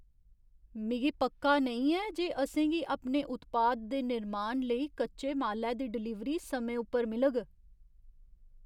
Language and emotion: Dogri, fearful